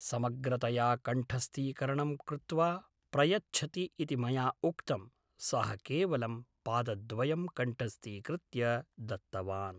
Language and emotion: Sanskrit, neutral